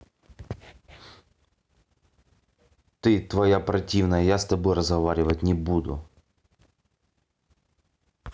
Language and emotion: Russian, angry